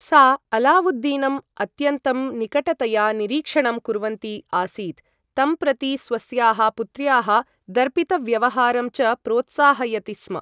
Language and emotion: Sanskrit, neutral